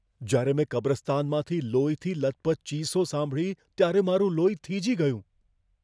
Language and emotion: Gujarati, fearful